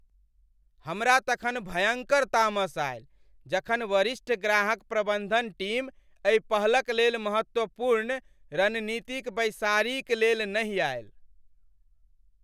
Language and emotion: Maithili, angry